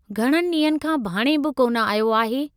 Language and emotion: Sindhi, neutral